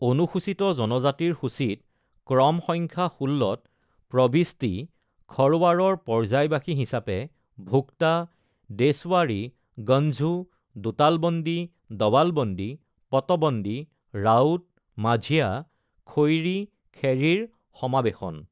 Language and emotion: Assamese, neutral